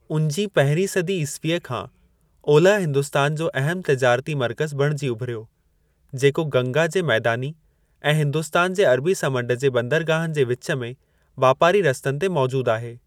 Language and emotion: Sindhi, neutral